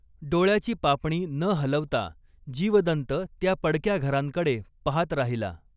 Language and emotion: Marathi, neutral